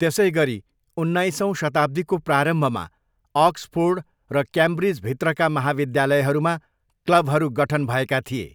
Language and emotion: Nepali, neutral